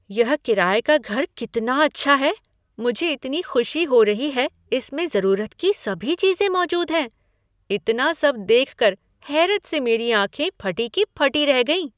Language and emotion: Hindi, surprised